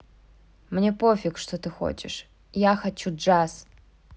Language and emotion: Russian, neutral